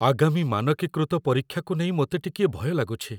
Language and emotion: Odia, fearful